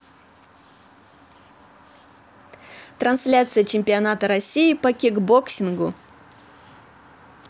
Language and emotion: Russian, positive